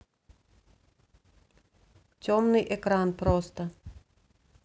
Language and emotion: Russian, neutral